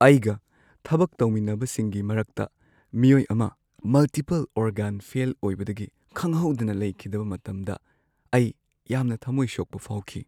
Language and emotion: Manipuri, sad